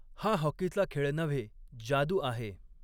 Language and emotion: Marathi, neutral